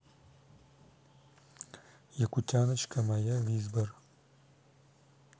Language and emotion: Russian, neutral